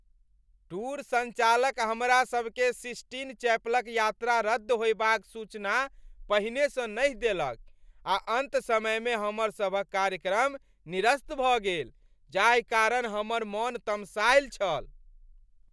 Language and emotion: Maithili, angry